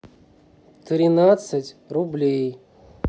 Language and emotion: Russian, neutral